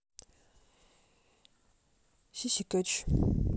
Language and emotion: Russian, neutral